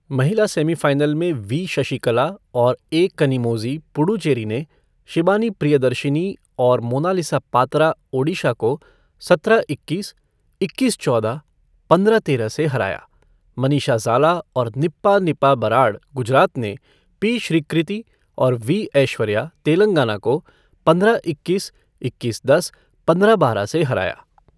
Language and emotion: Hindi, neutral